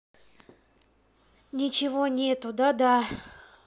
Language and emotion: Russian, sad